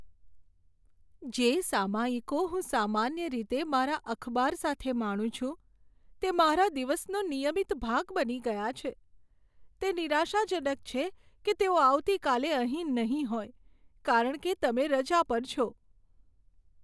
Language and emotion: Gujarati, sad